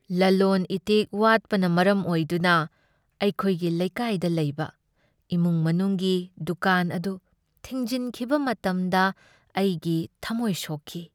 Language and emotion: Manipuri, sad